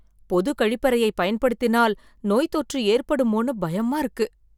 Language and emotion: Tamil, fearful